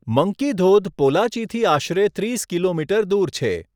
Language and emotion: Gujarati, neutral